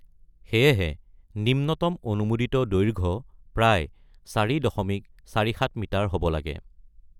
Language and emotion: Assamese, neutral